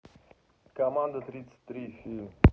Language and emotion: Russian, neutral